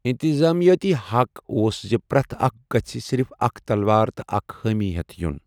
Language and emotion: Kashmiri, neutral